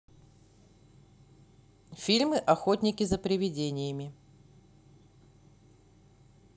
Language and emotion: Russian, neutral